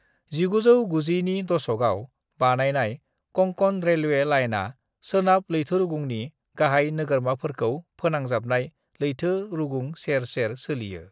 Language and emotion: Bodo, neutral